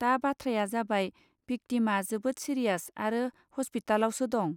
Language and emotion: Bodo, neutral